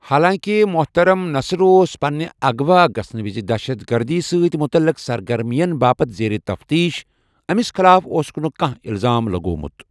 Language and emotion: Kashmiri, neutral